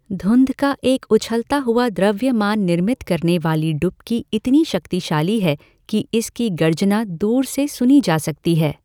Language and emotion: Hindi, neutral